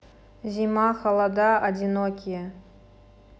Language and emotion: Russian, neutral